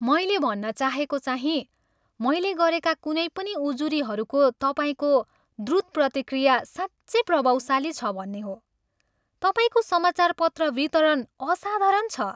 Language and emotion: Nepali, happy